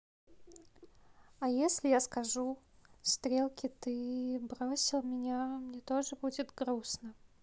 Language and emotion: Russian, neutral